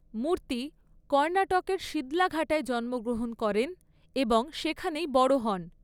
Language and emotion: Bengali, neutral